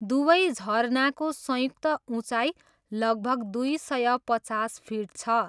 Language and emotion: Nepali, neutral